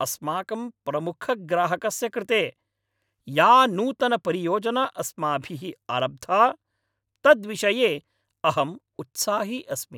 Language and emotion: Sanskrit, happy